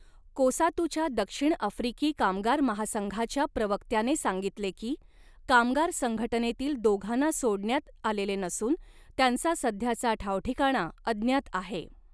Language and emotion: Marathi, neutral